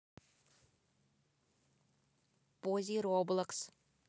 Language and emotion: Russian, neutral